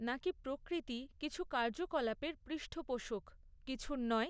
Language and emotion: Bengali, neutral